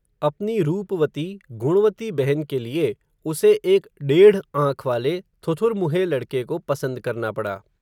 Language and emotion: Hindi, neutral